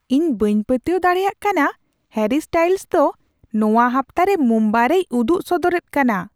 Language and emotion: Santali, surprised